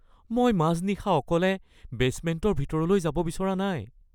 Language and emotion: Assamese, fearful